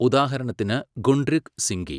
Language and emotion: Malayalam, neutral